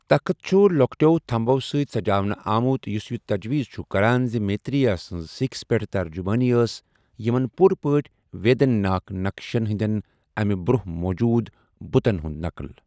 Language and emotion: Kashmiri, neutral